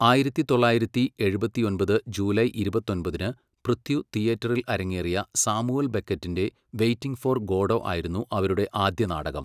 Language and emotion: Malayalam, neutral